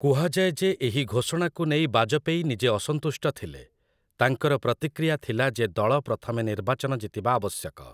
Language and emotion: Odia, neutral